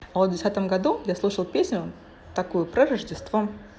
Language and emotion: Russian, positive